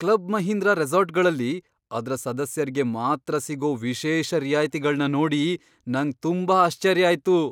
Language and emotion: Kannada, surprised